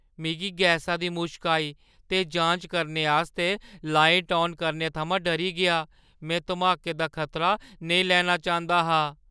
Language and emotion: Dogri, fearful